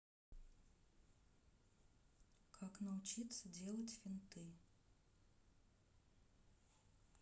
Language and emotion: Russian, neutral